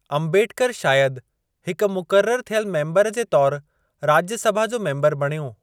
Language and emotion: Sindhi, neutral